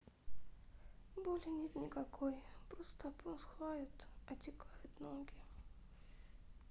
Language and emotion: Russian, sad